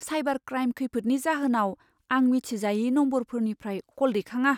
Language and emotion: Bodo, fearful